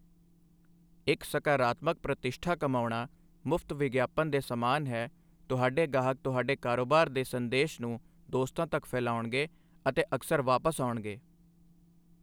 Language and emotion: Punjabi, neutral